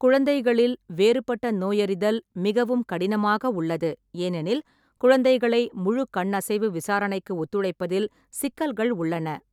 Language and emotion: Tamil, neutral